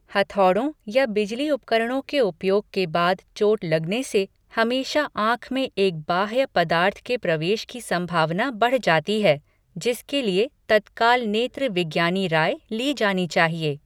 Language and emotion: Hindi, neutral